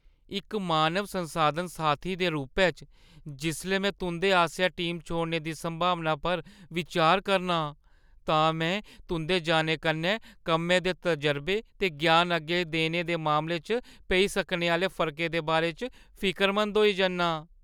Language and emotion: Dogri, fearful